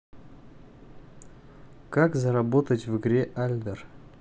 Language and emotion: Russian, neutral